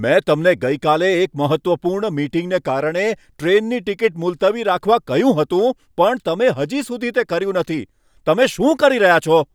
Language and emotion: Gujarati, angry